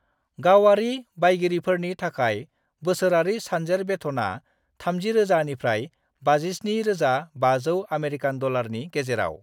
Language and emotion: Bodo, neutral